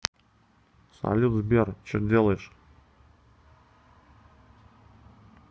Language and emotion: Russian, neutral